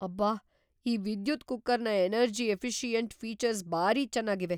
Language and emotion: Kannada, surprised